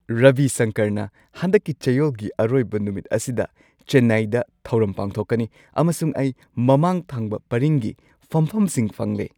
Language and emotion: Manipuri, happy